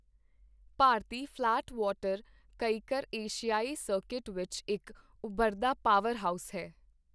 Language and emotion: Punjabi, neutral